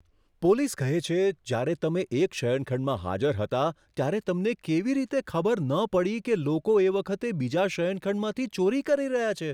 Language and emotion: Gujarati, surprised